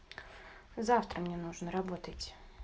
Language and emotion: Russian, neutral